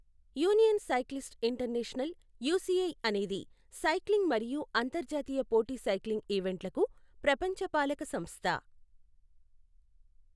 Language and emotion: Telugu, neutral